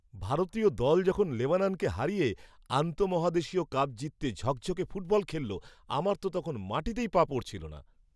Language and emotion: Bengali, happy